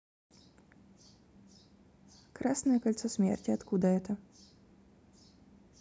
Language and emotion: Russian, neutral